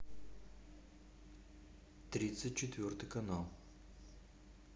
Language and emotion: Russian, neutral